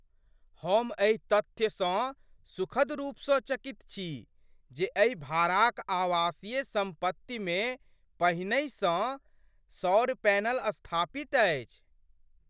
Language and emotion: Maithili, surprised